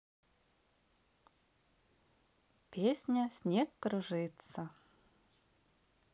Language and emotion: Russian, positive